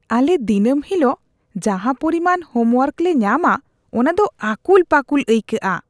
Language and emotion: Santali, disgusted